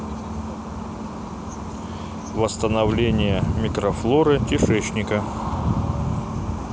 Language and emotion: Russian, neutral